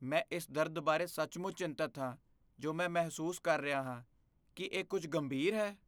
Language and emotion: Punjabi, fearful